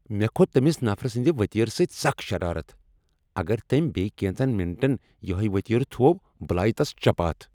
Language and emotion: Kashmiri, angry